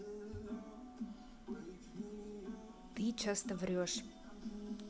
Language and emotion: Russian, neutral